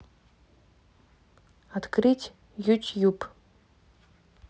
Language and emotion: Russian, neutral